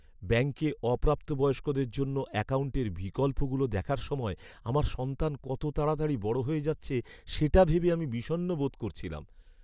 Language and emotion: Bengali, sad